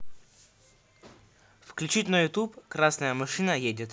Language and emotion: Russian, neutral